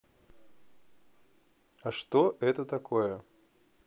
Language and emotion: Russian, neutral